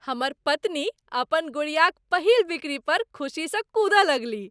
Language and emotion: Maithili, happy